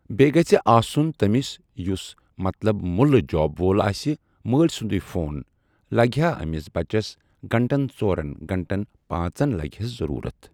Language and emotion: Kashmiri, neutral